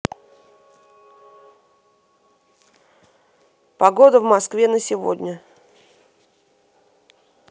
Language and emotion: Russian, neutral